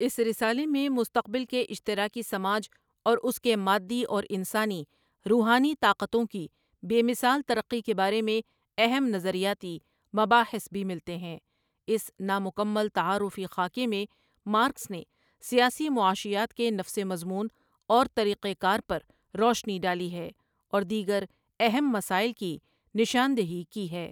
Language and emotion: Urdu, neutral